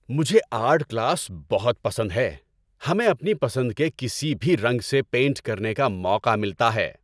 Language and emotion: Urdu, happy